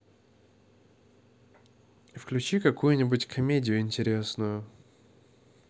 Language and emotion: Russian, neutral